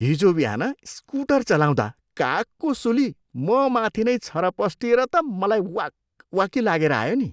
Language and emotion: Nepali, disgusted